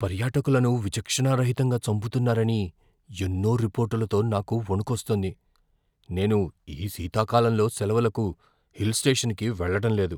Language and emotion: Telugu, fearful